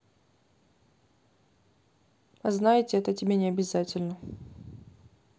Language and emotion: Russian, neutral